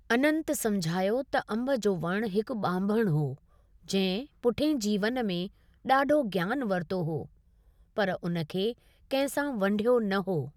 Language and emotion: Sindhi, neutral